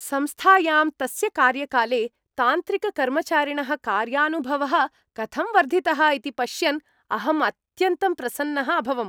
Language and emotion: Sanskrit, happy